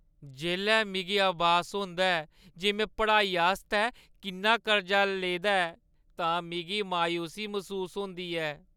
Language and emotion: Dogri, sad